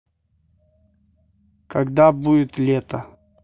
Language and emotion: Russian, neutral